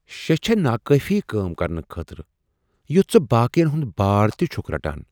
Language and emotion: Kashmiri, surprised